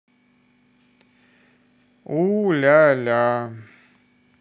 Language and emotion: Russian, neutral